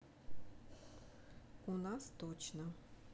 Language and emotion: Russian, neutral